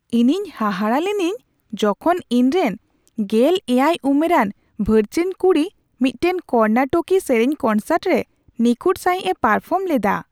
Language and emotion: Santali, surprised